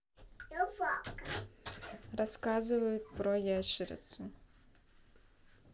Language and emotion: Russian, neutral